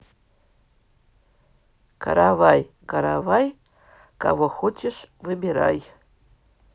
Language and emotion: Russian, neutral